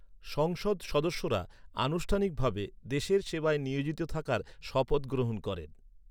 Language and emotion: Bengali, neutral